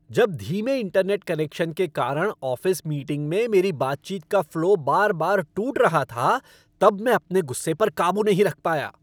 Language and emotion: Hindi, angry